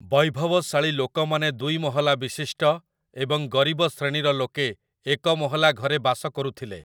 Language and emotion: Odia, neutral